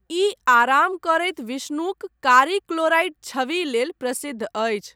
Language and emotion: Maithili, neutral